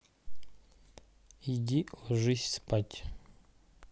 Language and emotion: Russian, neutral